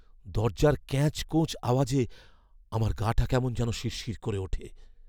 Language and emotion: Bengali, fearful